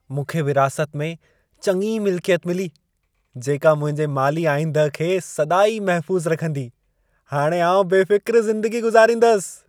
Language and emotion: Sindhi, happy